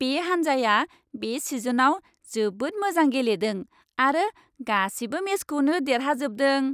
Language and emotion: Bodo, happy